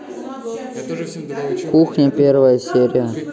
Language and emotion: Russian, neutral